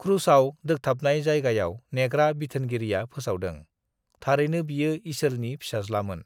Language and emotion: Bodo, neutral